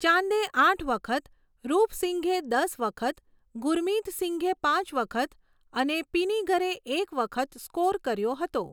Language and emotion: Gujarati, neutral